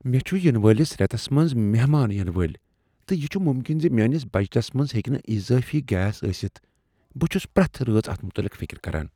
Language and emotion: Kashmiri, fearful